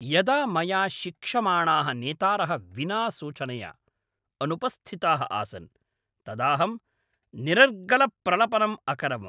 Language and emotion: Sanskrit, angry